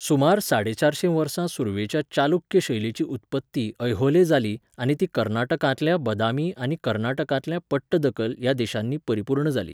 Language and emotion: Goan Konkani, neutral